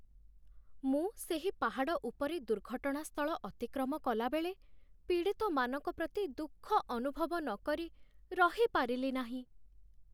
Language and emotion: Odia, sad